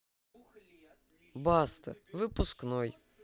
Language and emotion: Russian, neutral